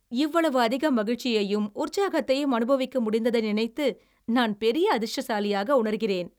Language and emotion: Tamil, happy